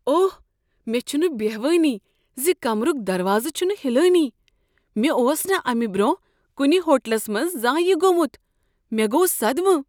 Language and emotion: Kashmiri, surprised